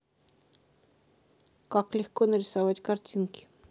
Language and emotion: Russian, neutral